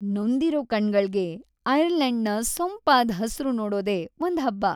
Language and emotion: Kannada, happy